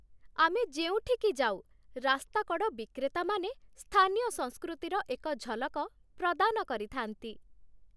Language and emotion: Odia, happy